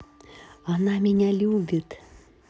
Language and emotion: Russian, positive